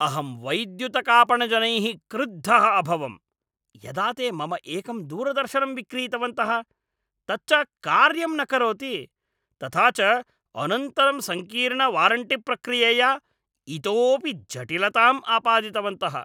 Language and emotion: Sanskrit, angry